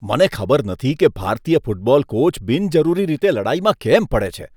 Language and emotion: Gujarati, disgusted